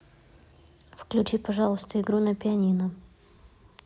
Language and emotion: Russian, neutral